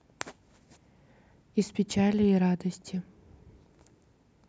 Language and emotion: Russian, neutral